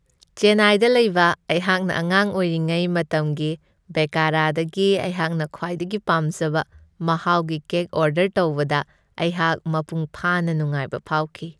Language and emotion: Manipuri, happy